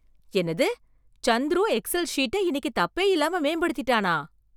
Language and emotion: Tamil, surprised